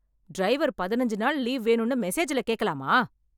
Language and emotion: Tamil, angry